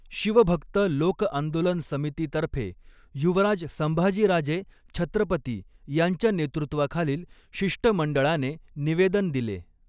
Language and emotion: Marathi, neutral